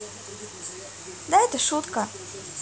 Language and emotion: Russian, neutral